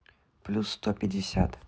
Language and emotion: Russian, neutral